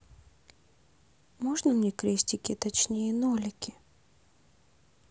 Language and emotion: Russian, neutral